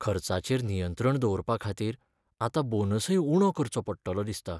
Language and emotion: Goan Konkani, sad